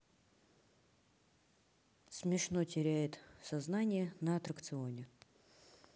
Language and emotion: Russian, neutral